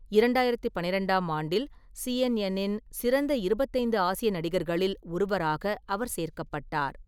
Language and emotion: Tamil, neutral